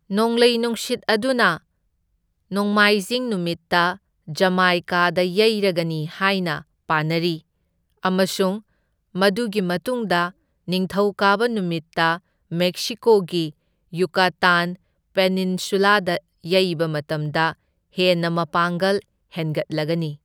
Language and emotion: Manipuri, neutral